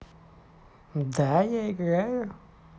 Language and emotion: Russian, positive